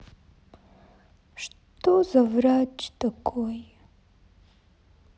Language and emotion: Russian, sad